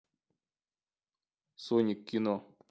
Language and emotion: Russian, neutral